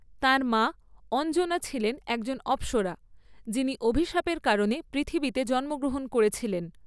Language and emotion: Bengali, neutral